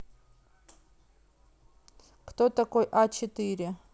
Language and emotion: Russian, neutral